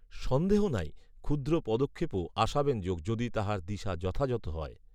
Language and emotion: Bengali, neutral